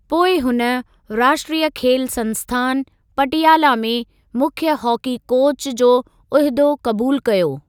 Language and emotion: Sindhi, neutral